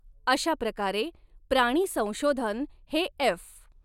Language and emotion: Marathi, neutral